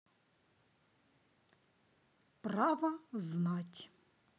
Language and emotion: Russian, neutral